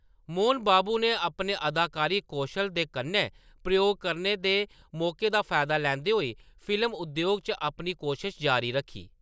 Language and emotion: Dogri, neutral